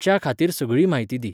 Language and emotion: Goan Konkani, neutral